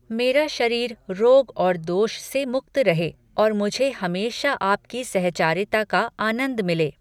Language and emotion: Hindi, neutral